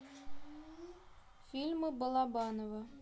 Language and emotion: Russian, neutral